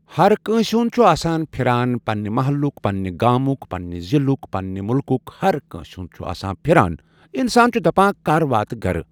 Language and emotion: Kashmiri, neutral